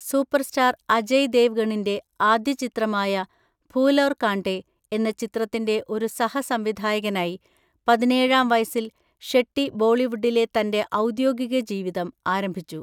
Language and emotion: Malayalam, neutral